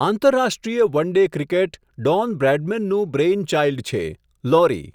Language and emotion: Gujarati, neutral